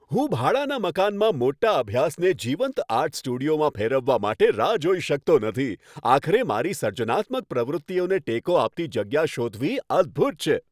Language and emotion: Gujarati, happy